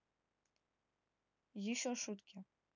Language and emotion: Russian, neutral